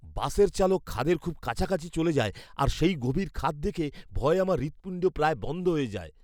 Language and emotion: Bengali, fearful